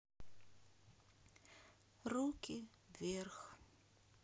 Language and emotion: Russian, sad